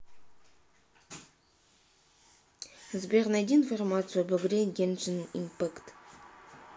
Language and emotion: Russian, neutral